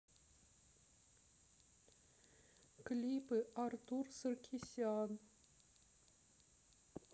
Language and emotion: Russian, sad